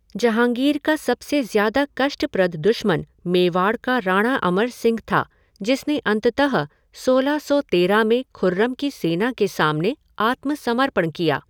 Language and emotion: Hindi, neutral